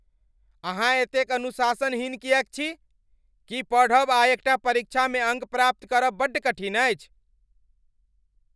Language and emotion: Maithili, angry